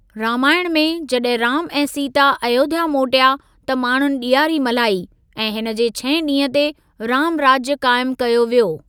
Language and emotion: Sindhi, neutral